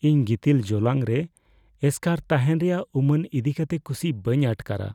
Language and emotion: Santali, fearful